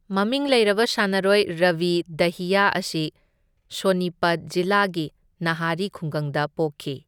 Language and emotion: Manipuri, neutral